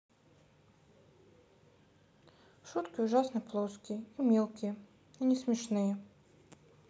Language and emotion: Russian, sad